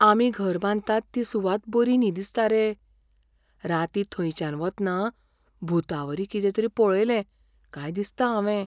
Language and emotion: Goan Konkani, fearful